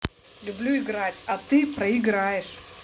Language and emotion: Russian, angry